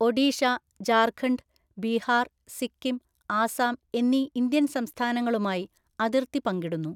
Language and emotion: Malayalam, neutral